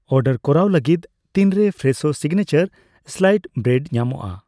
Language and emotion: Santali, neutral